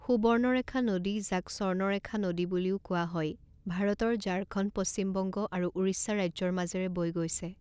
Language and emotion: Assamese, neutral